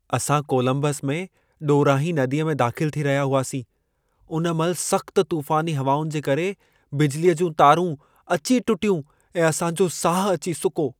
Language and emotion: Sindhi, fearful